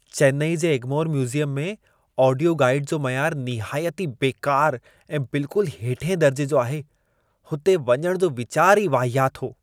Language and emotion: Sindhi, disgusted